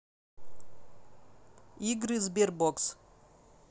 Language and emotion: Russian, neutral